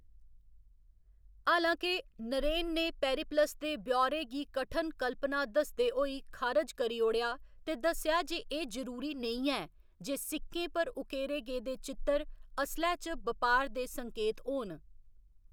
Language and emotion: Dogri, neutral